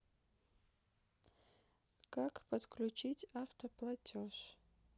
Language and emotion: Russian, neutral